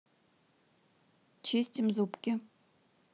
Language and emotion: Russian, neutral